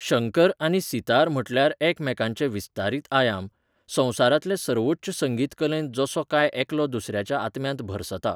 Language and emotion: Goan Konkani, neutral